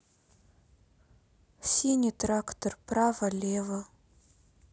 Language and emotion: Russian, sad